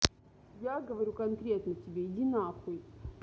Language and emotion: Russian, angry